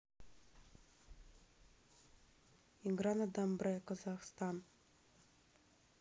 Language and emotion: Russian, neutral